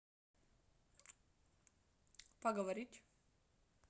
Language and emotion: Russian, neutral